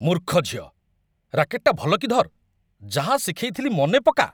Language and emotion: Odia, angry